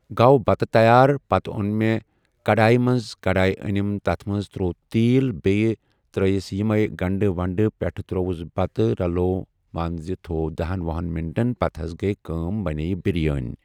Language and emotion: Kashmiri, neutral